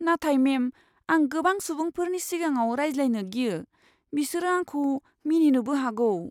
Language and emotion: Bodo, fearful